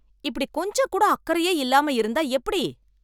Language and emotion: Tamil, angry